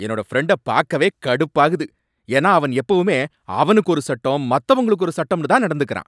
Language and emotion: Tamil, angry